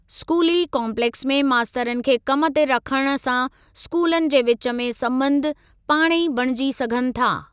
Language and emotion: Sindhi, neutral